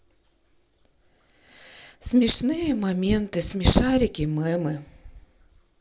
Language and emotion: Russian, sad